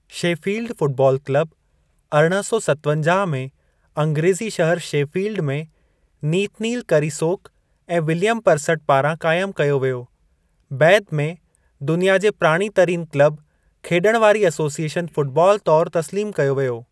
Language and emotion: Sindhi, neutral